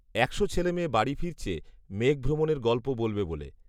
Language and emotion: Bengali, neutral